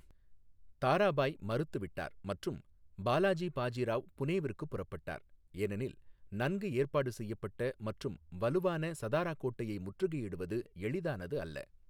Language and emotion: Tamil, neutral